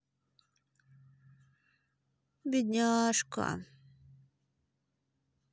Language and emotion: Russian, sad